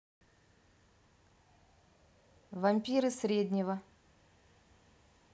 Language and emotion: Russian, neutral